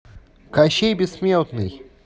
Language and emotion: Russian, neutral